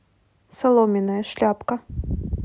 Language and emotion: Russian, neutral